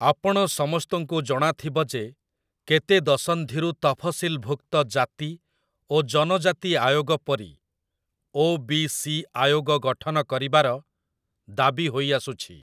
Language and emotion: Odia, neutral